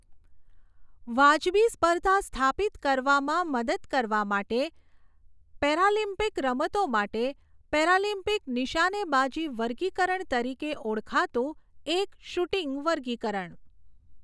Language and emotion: Gujarati, neutral